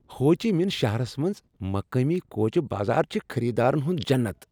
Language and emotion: Kashmiri, happy